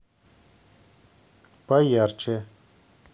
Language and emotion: Russian, neutral